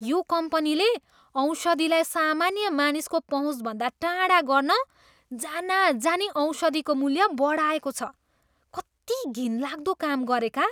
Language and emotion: Nepali, disgusted